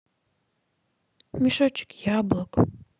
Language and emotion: Russian, sad